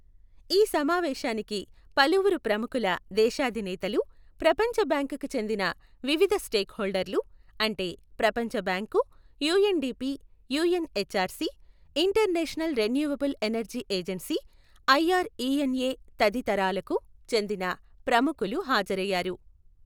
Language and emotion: Telugu, neutral